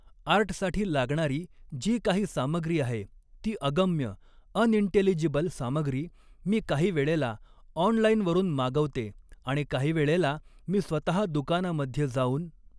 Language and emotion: Marathi, neutral